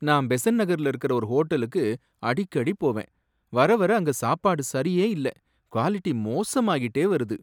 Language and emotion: Tamil, sad